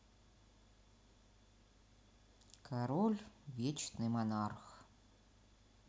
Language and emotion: Russian, sad